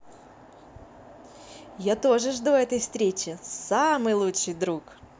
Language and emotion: Russian, positive